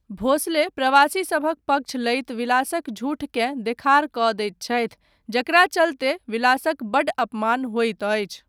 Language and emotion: Maithili, neutral